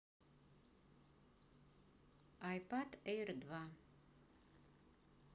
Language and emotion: Russian, neutral